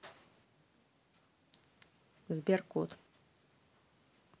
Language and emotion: Russian, neutral